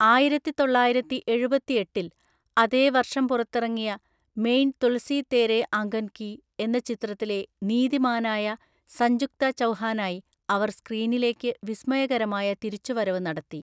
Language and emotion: Malayalam, neutral